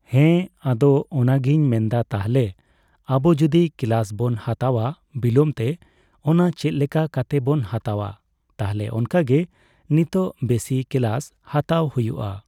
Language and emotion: Santali, neutral